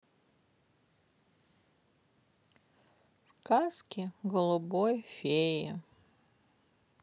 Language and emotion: Russian, sad